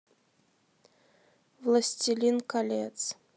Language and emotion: Russian, neutral